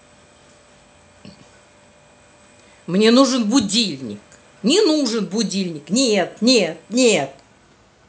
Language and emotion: Russian, angry